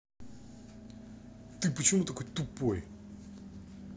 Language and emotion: Russian, angry